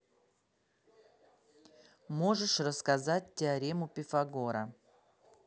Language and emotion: Russian, neutral